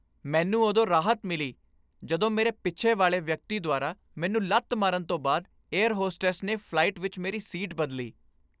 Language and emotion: Punjabi, happy